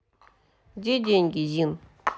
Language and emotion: Russian, neutral